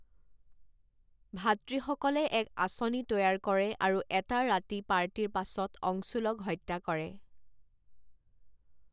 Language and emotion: Assamese, neutral